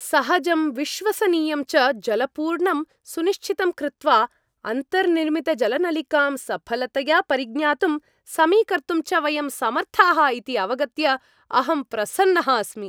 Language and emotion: Sanskrit, happy